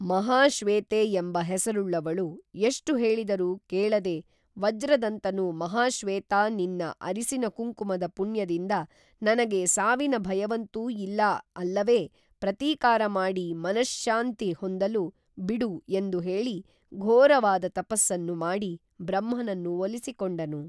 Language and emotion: Kannada, neutral